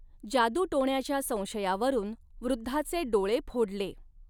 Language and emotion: Marathi, neutral